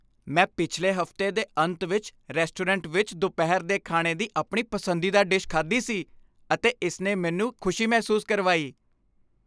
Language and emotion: Punjabi, happy